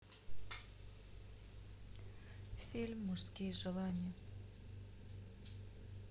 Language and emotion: Russian, sad